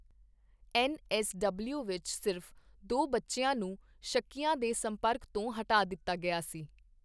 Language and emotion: Punjabi, neutral